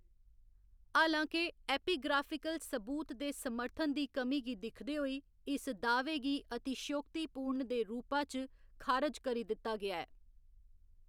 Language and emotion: Dogri, neutral